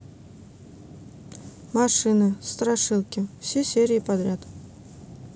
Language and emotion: Russian, neutral